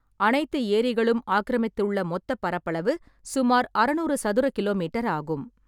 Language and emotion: Tamil, neutral